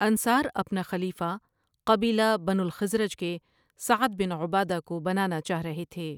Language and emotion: Urdu, neutral